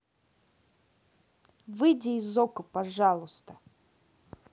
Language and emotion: Russian, angry